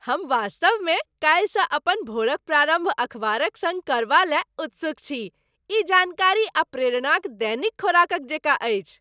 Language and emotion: Maithili, happy